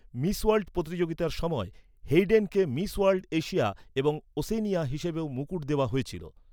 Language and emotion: Bengali, neutral